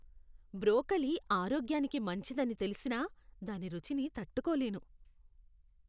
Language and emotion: Telugu, disgusted